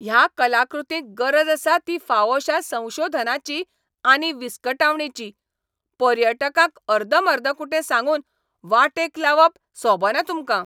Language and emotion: Goan Konkani, angry